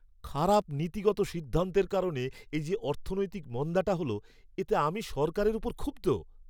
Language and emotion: Bengali, angry